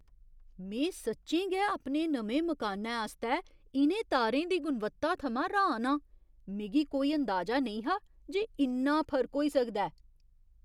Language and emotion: Dogri, surprised